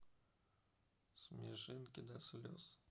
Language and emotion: Russian, sad